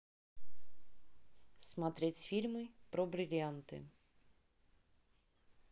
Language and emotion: Russian, neutral